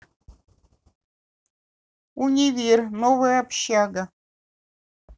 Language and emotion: Russian, neutral